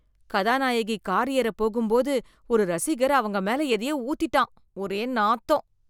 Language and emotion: Tamil, disgusted